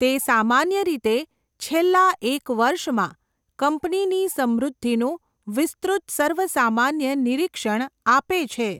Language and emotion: Gujarati, neutral